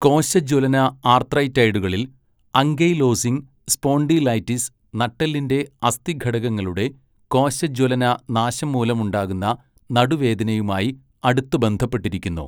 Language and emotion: Malayalam, neutral